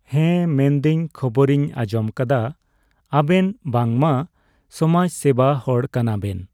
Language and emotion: Santali, neutral